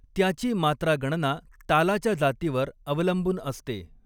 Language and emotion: Marathi, neutral